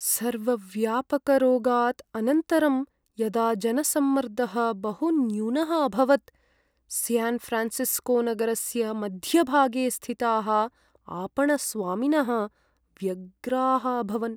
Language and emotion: Sanskrit, sad